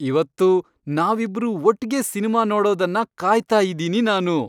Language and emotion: Kannada, happy